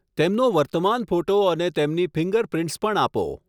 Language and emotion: Gujarati, neutral